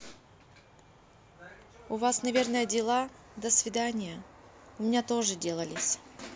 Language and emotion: Russian, neutral